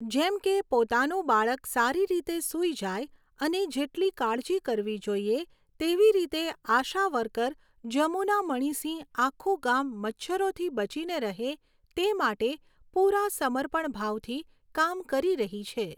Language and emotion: Gujarati, neutral